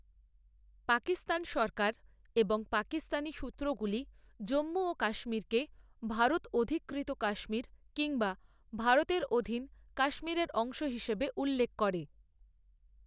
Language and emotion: Bengali, neutral